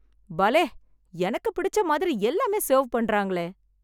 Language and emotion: Tamil, happy